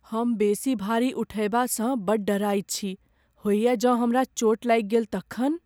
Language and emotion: Maithili, fearful